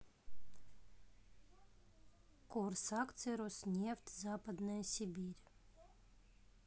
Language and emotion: Russian, neutral